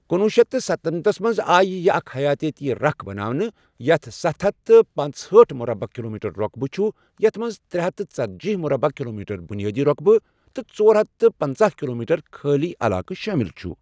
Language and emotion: Kashmiri, neutral